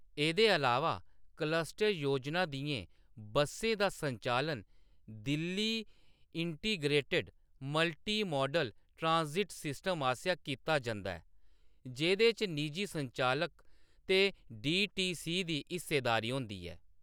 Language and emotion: Dogri, neutral